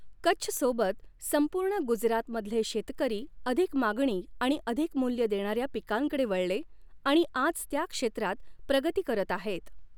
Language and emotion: Marathi, neutral